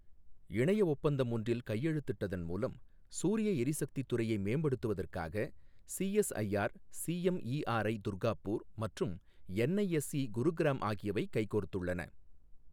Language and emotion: Tamil, neutral